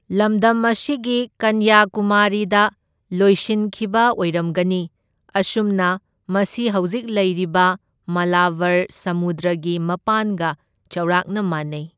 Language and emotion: Manipuri, neutral